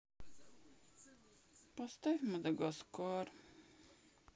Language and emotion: Russian, sad